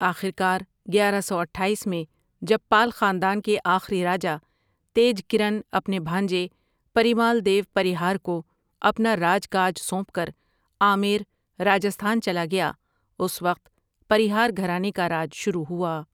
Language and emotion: Urdu, neutral